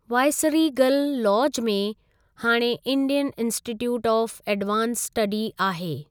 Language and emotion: Sindhi, neutral